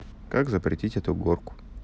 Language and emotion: Russian, neutral